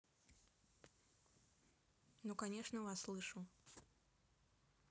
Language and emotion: Russian, neutral